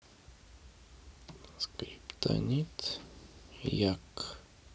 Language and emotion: Russian, neutral